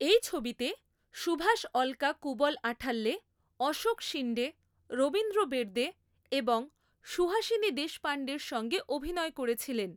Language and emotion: Bengali, neutral